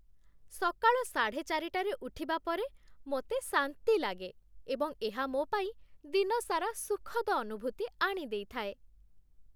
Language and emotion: Odia, happy